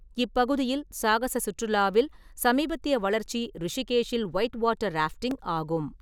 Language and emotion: Tamil, neutral